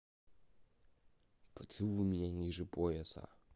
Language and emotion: Russian, neutral